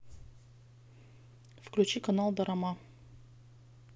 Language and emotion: Russian, neutral